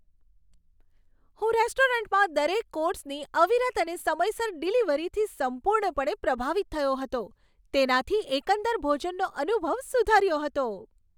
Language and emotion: Gujarati, happy